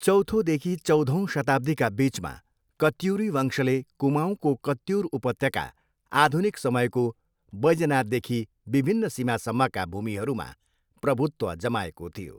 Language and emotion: Nepali, neutral